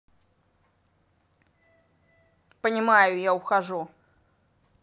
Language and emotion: Russian, angry